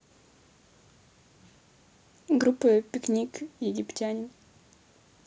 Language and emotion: Russian, neutral